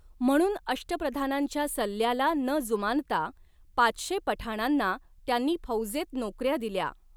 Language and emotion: Marathi, neutral